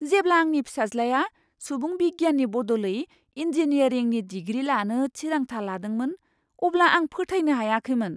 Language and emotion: Bodo, surprised